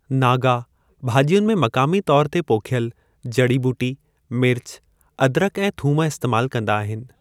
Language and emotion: Sindhi, neutral